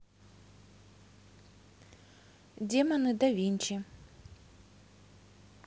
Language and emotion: Russian, neutral